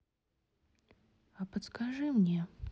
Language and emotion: Russian, sad